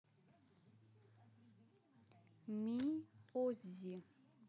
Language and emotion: Russian, neutral